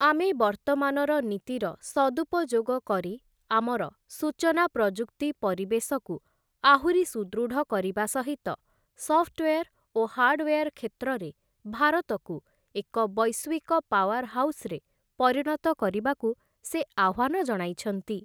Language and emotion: Odia, neutral